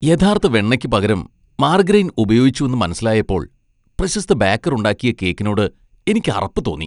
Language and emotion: Malayalam, disgusted